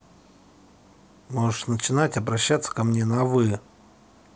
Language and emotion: Russian, angry